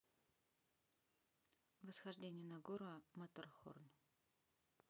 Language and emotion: Russian, neutral